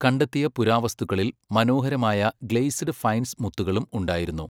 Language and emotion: Malayalam, neutral